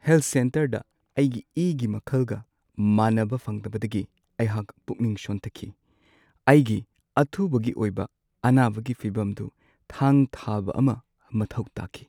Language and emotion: Manipuri, sad